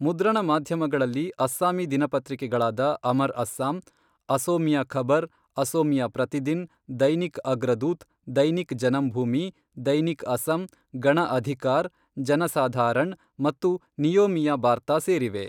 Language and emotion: Kannada, neutral